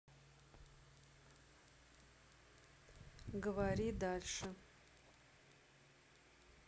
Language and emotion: Russian, neutral